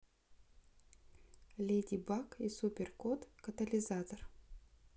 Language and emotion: Russian, neutral